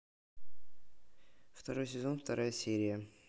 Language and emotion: Russian, neutral